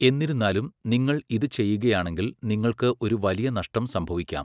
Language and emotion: Malayalam, neutral